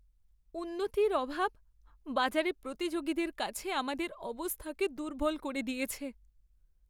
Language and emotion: Bengali, sad